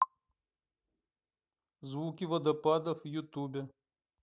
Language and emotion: Russian, neutral